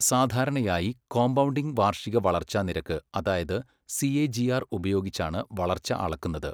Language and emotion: Malayalam, neutral